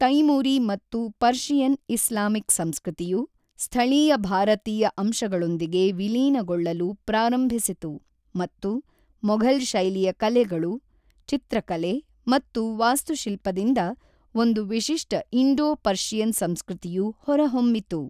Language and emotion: Kannada, neutral